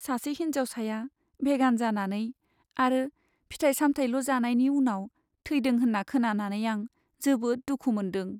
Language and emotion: Bodo, sad